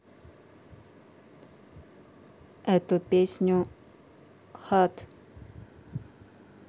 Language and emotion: Russian, neutral